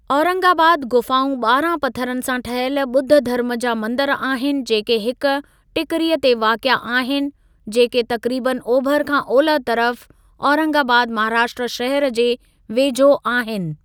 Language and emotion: Sindhi, neutral